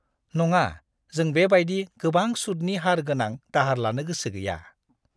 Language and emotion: Bodo, disgusted